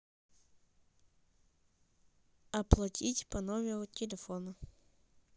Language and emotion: Russian, neutral